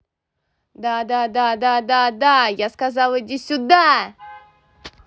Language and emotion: Russian, positive